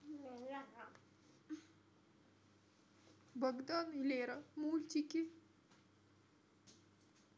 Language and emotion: Russian, sad